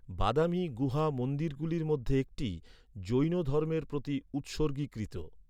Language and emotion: Bengali, neutral